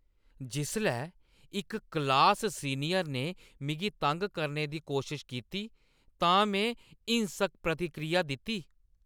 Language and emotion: Dogri, angry